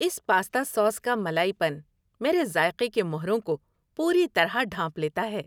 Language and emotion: Urdu, happy